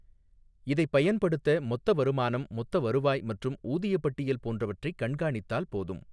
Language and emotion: Tamil, neutral